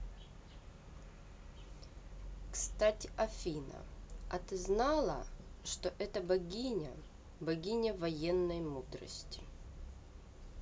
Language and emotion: Russian, neutral